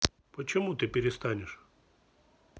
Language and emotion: Russian, neutral